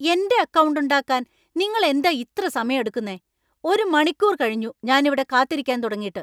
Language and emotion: Malayalam, angry